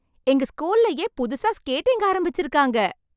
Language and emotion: Tamil, happy